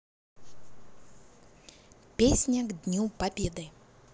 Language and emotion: Russian, positive